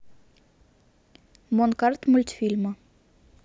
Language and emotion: Russian, neutral